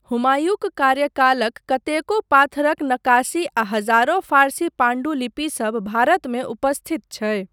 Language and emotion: Maithili, neutral